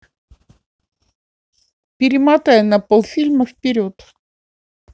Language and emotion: Russian, neutral